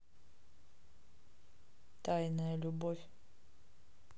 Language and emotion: Russian, neutral